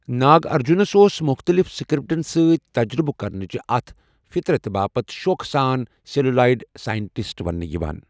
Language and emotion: Kashmiri, neutral